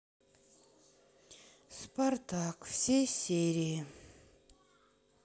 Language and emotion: Russian, sad